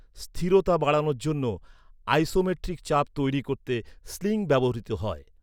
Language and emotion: Bengali, neutral